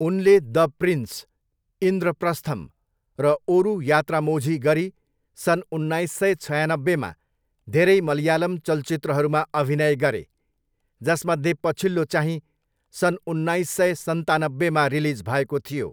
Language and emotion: Nepali, neutral